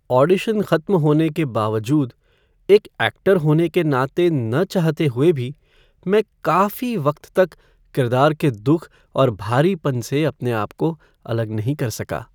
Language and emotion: Hindi, sad